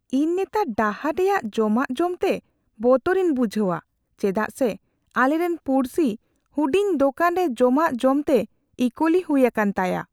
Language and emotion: Santali, fearful